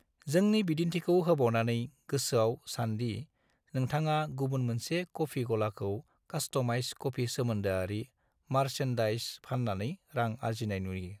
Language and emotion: Bodo, neutral